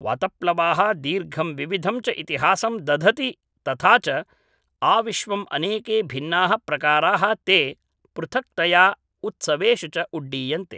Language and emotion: Sanskrit, neutral